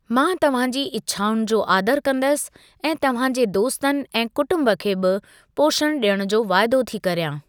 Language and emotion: Sindhi, neutral